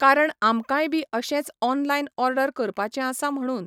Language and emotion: Goan Konkani, neutral